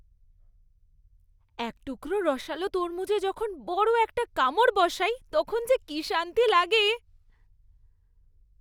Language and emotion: Bengali, happy